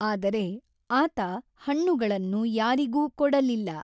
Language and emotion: Kannada, neutral